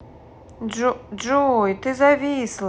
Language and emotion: Russian, neutral